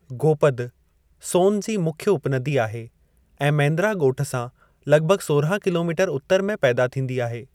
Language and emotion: Sindhi, neutral